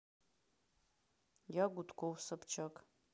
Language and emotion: Russian, neutral